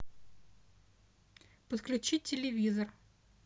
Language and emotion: Russian, neutral